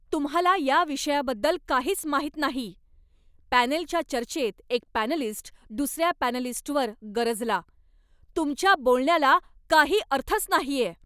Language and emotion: Marathi, angry